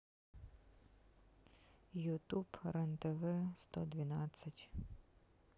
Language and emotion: Russian, sad